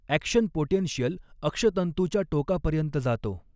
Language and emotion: Marathi, neutral